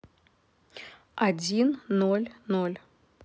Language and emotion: Russian, neutral